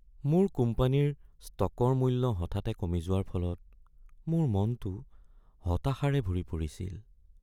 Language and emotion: Assamese, sad